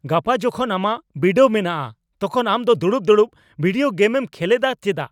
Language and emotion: Santali, angry